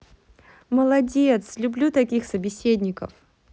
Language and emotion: Russian, positive